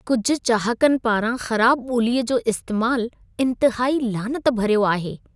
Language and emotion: Sindhi, disgusted